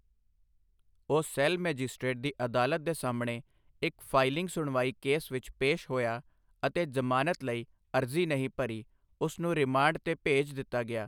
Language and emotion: Punjabi, neutral